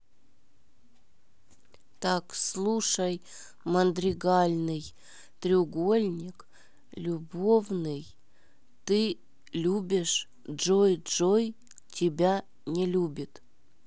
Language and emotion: Russian, neutral